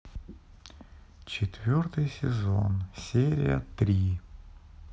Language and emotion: Russian, sad